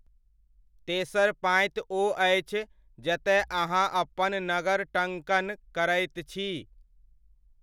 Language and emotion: Maithili, neutral